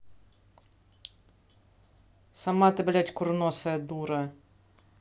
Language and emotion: Russian, angry